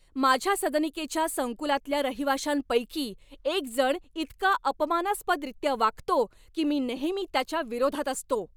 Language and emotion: Marathi, angry